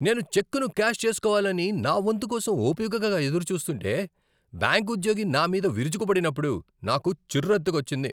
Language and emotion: Telugu, angry